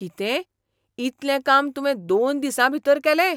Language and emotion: Goan Konkani, surprised